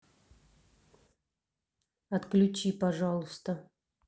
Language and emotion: Russian, neutral